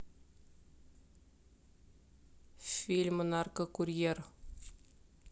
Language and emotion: Russian, neutral